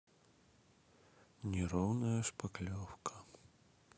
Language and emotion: Russian, sad